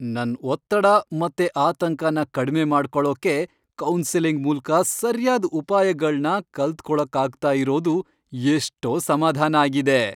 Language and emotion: Kannada, happy